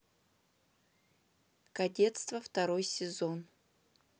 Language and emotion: Russian, neutral